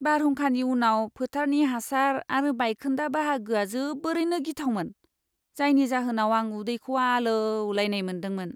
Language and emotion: Bodo, disgusted